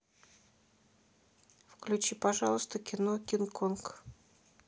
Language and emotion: Russian, neutral